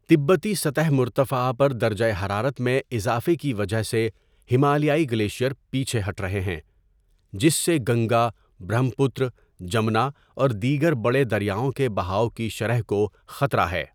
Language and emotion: Urdu, neutral